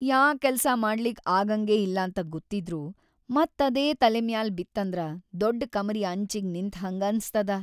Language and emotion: Kannada, sad